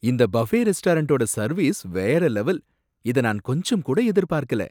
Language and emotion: Tamil, surprised